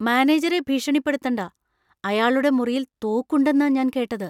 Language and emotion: Malayalam, fearful